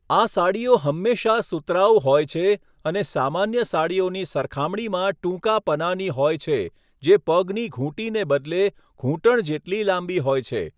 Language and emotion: Gujarati, neutral